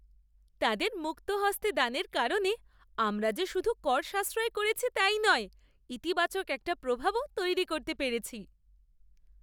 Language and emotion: Bengali, happy